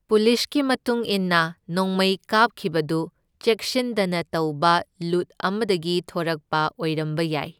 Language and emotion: Manipuri, neutral